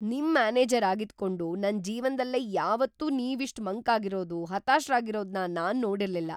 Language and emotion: Kannada, surprised